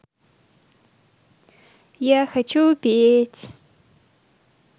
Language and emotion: Russian, positive